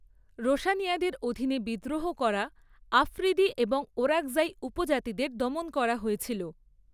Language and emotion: Bengali, neutral